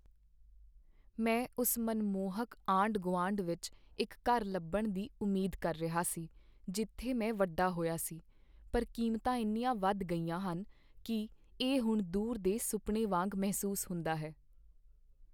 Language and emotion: Punjabi, sad